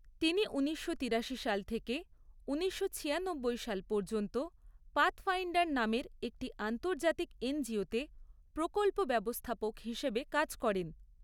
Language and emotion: Bengali, neutral